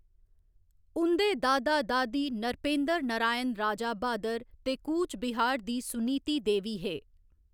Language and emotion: Dogri, neutral